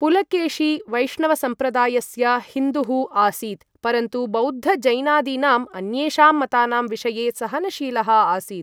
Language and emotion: Sanskrit, neutral